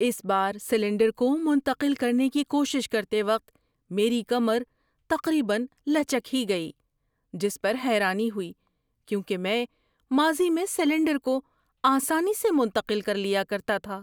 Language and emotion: Urdu, surprised